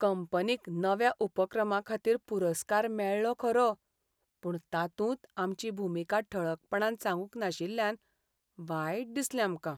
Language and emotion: Goan Konkani, sad